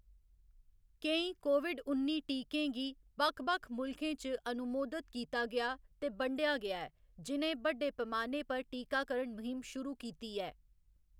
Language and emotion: Dogri, neutral